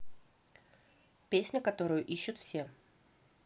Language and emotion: Russian, neutral